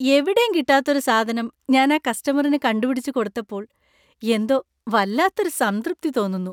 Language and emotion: Malayalam, happy